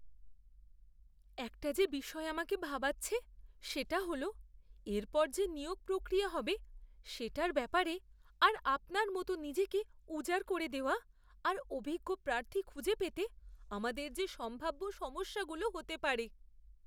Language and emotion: Bengali, fearful